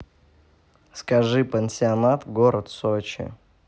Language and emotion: Russian, neutral